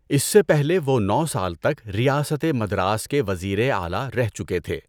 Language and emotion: Urdu, neutral